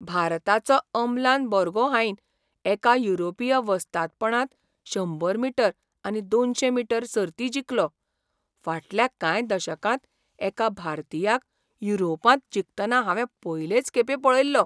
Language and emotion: Goan Konkani, surprised